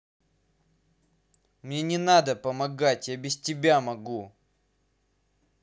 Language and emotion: Russian, angry